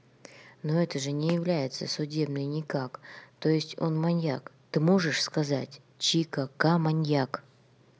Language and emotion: Russian, neutral